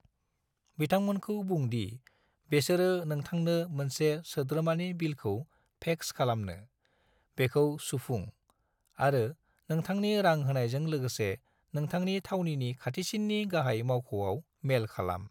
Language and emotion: Bodo, neutral